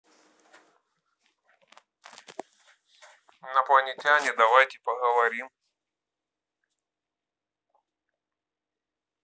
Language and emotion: Russian, neutral